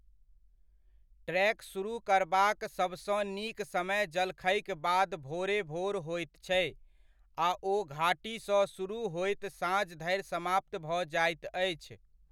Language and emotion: Maithili, neutral